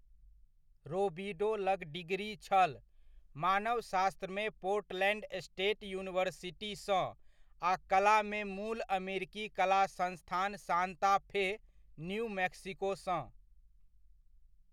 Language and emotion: Maithili, neutral